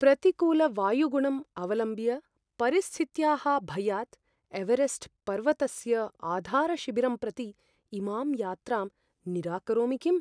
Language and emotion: Sanskrit, fearful